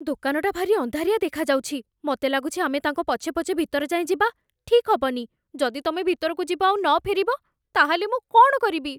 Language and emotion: Odia, fearful